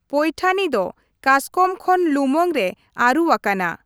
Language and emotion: Santali, neutral